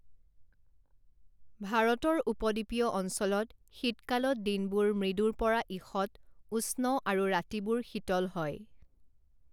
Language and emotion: Assamese, neutral